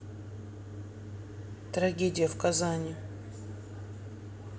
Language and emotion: Russian, sad